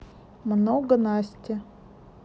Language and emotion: Russian, neutral